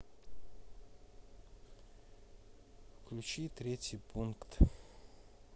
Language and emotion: Russian, neutral